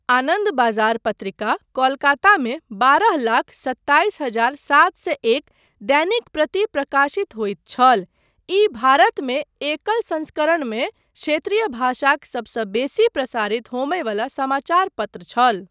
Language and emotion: Maithili, neutral